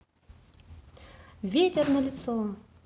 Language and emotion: Russian, positive